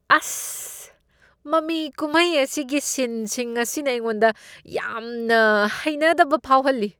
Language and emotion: Manipuri, disgusted